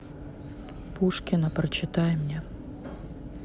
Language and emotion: Russian, neutral